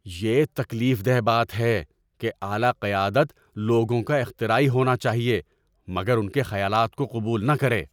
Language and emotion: Urdu, angry